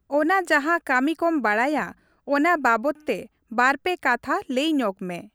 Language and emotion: Santali, neutral